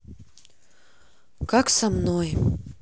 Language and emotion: Russian, sad